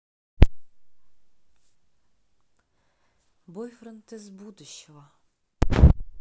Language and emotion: Russian, neutral